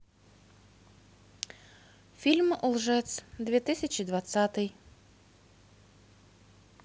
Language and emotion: Russian, neutral